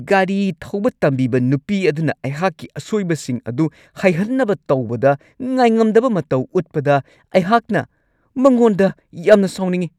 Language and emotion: Manipuri, angry